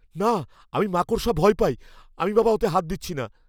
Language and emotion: Bengali, fearful